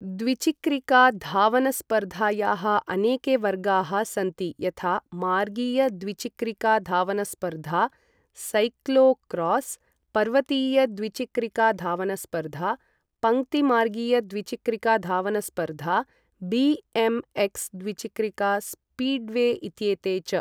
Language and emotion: Sanskrit, neutral